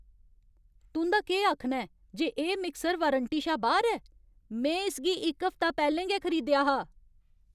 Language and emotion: Dogri, angry